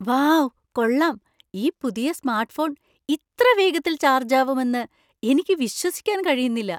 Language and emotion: Malayalam, surprised